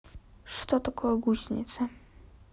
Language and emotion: Russian, neutral